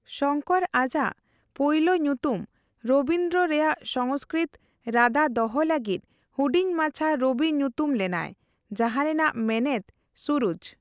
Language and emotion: Santali, neutral